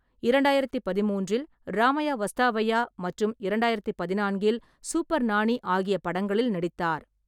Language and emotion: Tamil, neutral